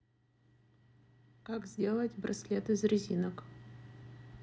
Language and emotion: Russian, neutral